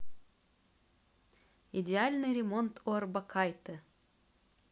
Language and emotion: Russian, positive